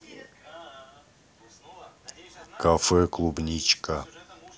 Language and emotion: Russian, neutral